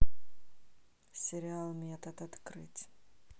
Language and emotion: Russian, neutral